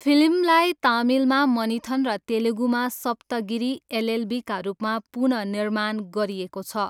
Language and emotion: Nepali, neutral